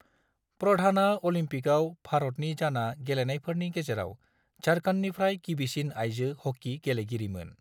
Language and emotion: Bodo, neutral